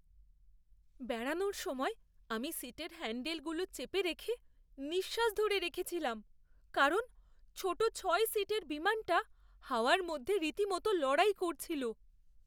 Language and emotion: Bengali, fearful